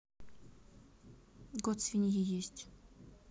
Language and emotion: Russian, neutral